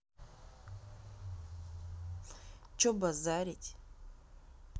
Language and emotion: Russian, angry